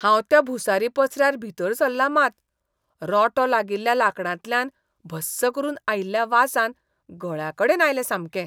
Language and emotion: Goan Konkani, disgusted